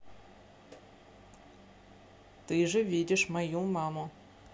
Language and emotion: Russian, neutral